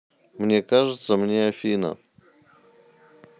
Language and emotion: Russian, neutral